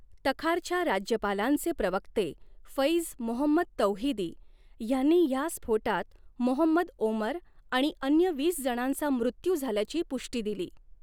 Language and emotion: Marathi, neutral